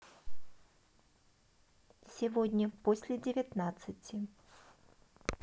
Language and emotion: Russian, neutral